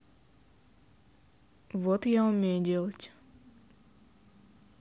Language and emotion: Russian, neutral